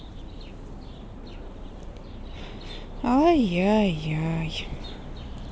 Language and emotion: Russian, sad